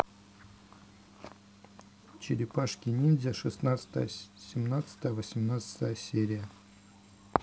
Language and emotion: Russian, neutral